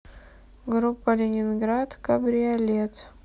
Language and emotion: Russian, neutral